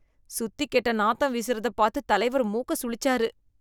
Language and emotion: Tamil, disgusted